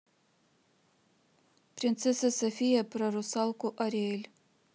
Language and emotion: Russian, neutral